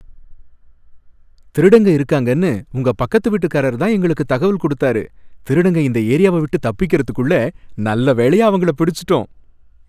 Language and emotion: Tamil, happy